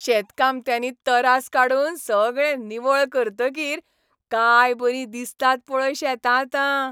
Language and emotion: Goan Konkani, happy